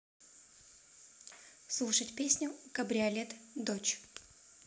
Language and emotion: Russian, neutral